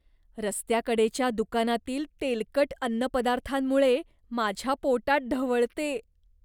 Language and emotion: Marathi, disgusted